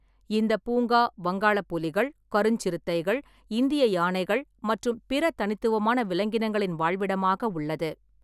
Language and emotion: Tamil, neutral